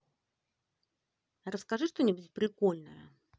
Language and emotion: Russian, positive